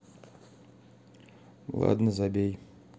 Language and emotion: Russian, neutral